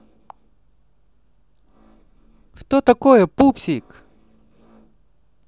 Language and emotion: Russian, positive